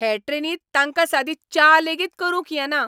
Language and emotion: Goan Konkani, angry